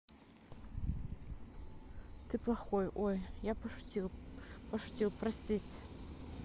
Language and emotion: Russian, neutral